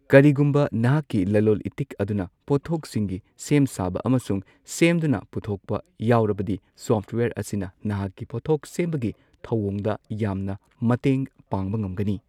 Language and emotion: Manipuri, neutral